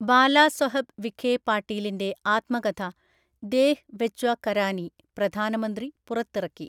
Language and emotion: Malayalam, neutral